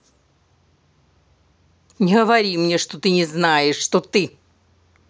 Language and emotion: Russian, angry